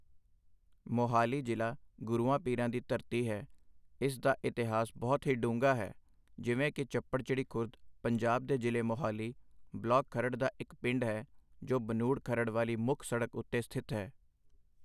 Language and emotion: Punjabi, neutral